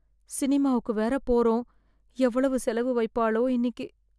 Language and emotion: Tamil, fearful